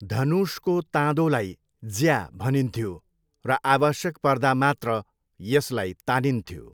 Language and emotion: Nepali, neutral